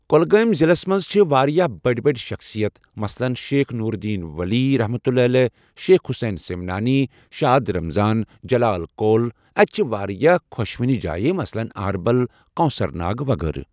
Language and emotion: Kashmiri, neutral